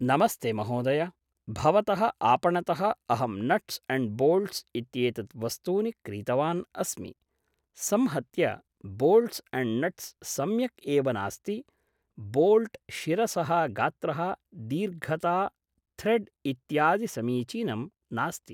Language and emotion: Sanskrit, neutral